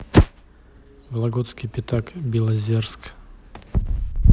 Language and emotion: Russian, neutral